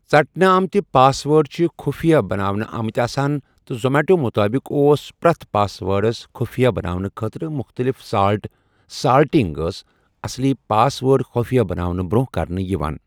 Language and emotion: Kashmiri, neutral